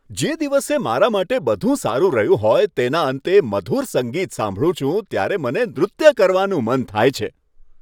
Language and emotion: Gujarati, happy